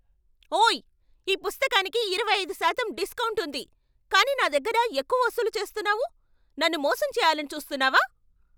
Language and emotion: Telugu, angry